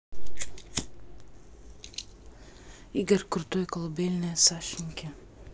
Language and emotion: Russian, neutral